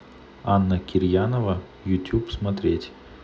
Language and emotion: Russian, neutral